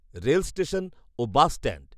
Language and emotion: Bengali, neutral